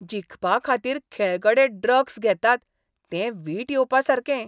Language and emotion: Goan Konkani, disgusted